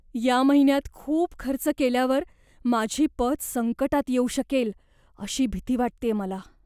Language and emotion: Marathi, fearful